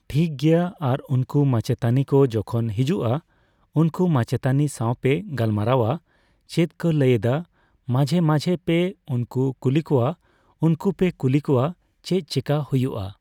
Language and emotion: Santali, neutral